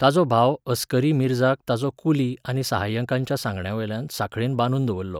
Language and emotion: Goan Konkani, neutral